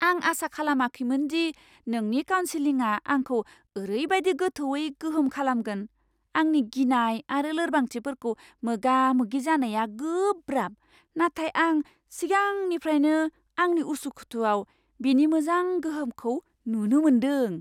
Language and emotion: Bodo, surprised